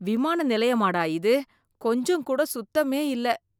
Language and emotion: Tamil, disgusted